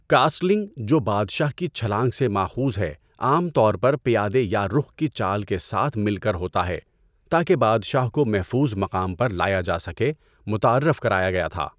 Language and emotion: Urdu, neutral